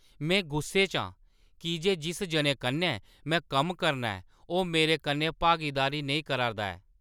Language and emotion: Dogri, angry